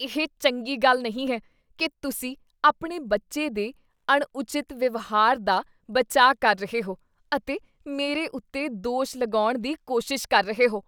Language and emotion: Punjabi, disgusted